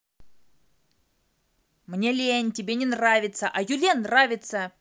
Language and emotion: Russian, angry